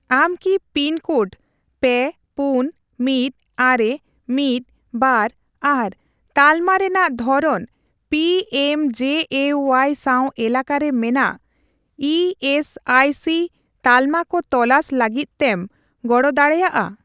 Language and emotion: Santali, neutral